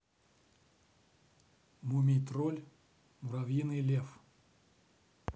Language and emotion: Russian, neutral